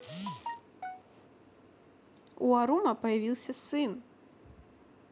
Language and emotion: Russian, positive